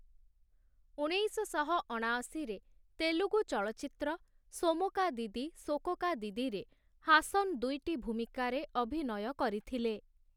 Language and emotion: Odia, neutral